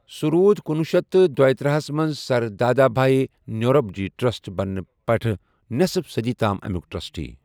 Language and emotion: Kashmiri, neutral